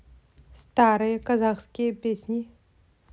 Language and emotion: Russian, neutral